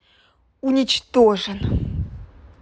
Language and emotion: Russian, angry